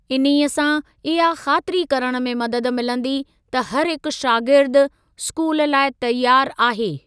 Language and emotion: Sindhi, neutral